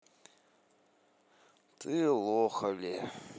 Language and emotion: Russian, sad